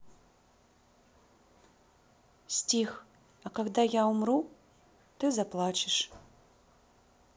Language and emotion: Russian, neutral